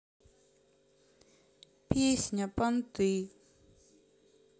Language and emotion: Russian, sad